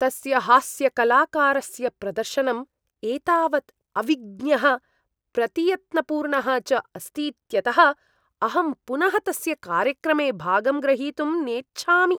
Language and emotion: Sanskrit, disgusted